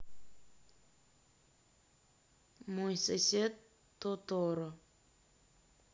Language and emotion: Russian, neutral